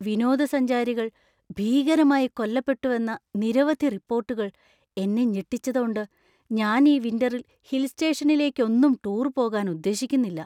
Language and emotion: Malayalam, fearful